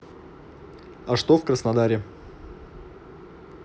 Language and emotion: Russian, neutral